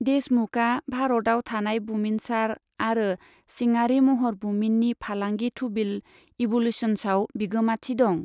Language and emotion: Bodo, neutral